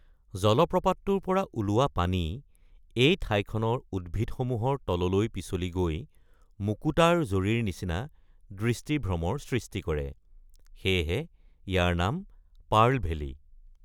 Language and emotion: Assamese, neutral